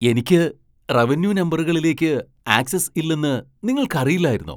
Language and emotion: Malayalam, surprised